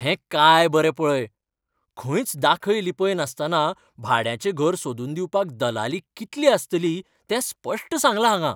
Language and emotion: Goan Konkani, happy